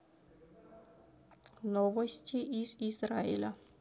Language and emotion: Russian, neutral